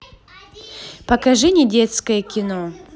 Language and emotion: Russian, positive